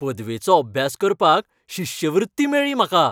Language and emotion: Goan Konkani, happy